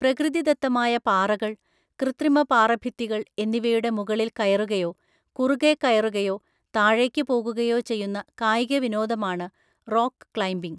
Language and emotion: Malayalam, neutral